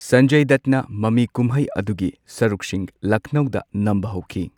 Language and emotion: Manipuri, neutral